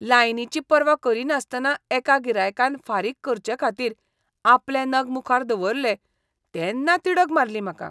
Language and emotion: Goan Konkani, disgusted